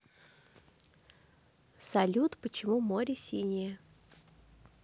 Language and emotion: Russian, neutral